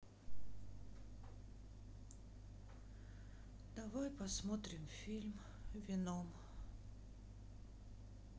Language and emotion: Russian, sad